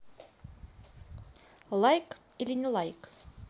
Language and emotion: Russian, neutral